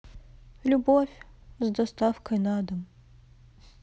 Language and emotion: Russian, sad